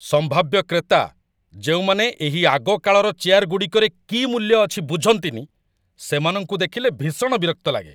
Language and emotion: Odia, angry